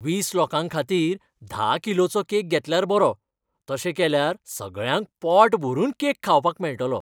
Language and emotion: Goan Konkani, happy